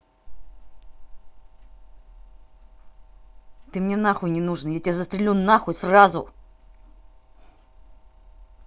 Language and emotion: Russian, angry